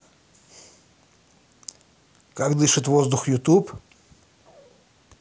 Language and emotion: Russian, positive